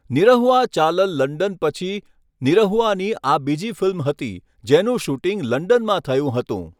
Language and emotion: Gujarati, neutral